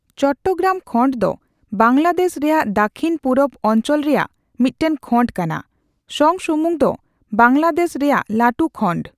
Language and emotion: Santali, neutral